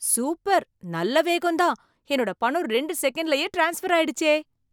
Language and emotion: Tamil, surprised